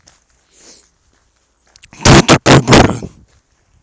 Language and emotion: Russian, angry